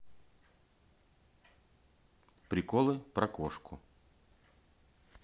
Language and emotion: Russian, neutral